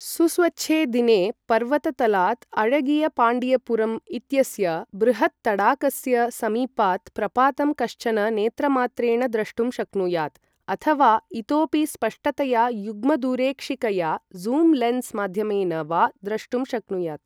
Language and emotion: Sanskrit, neutral